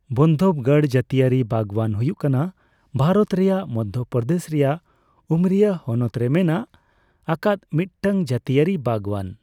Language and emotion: Santali, neutral